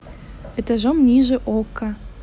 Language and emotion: Russian, neutral